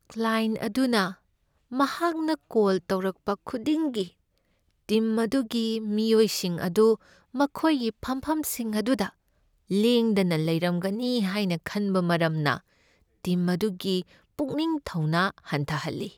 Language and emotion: Manipuri, sad